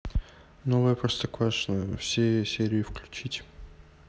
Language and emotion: Russian, neutral